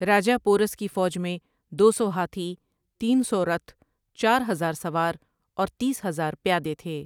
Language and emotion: Urdu, neutral